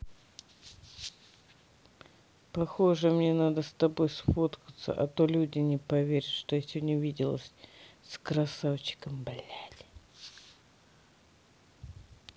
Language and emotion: Russian, neutral